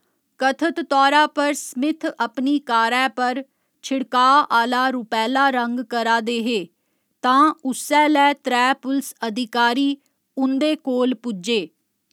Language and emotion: Dogri, neutral